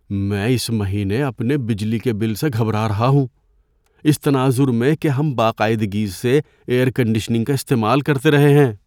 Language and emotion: Urdu, fearful